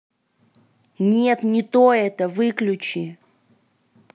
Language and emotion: Russian, angry